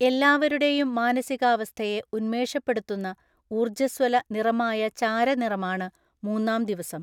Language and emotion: Malayalam, neutral